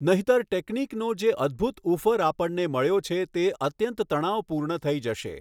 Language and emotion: Gujarati, neutral